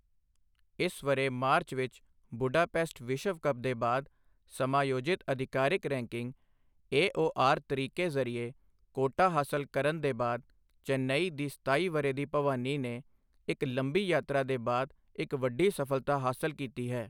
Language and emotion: Punjabi, neutral